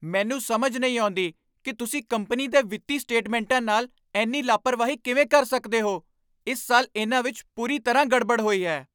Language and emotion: Punjabi, angry